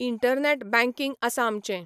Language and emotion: Goan Konkani, neutral